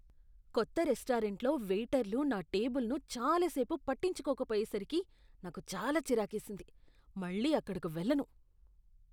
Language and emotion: Telugu, disgusted